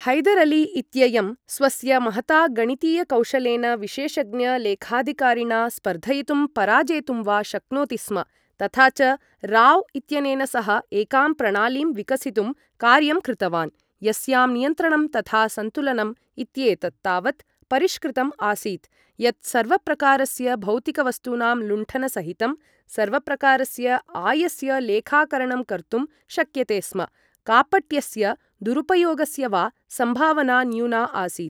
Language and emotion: Sanskrit, neutral